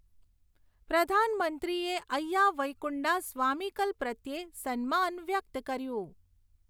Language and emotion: Gujarati, neutral